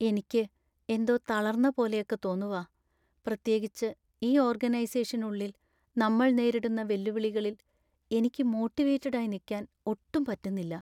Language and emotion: Malayalam, sad